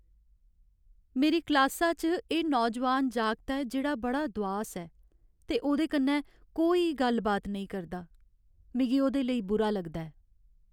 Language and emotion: Dogri, sad